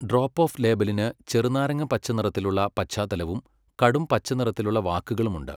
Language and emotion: Malayalam, neutral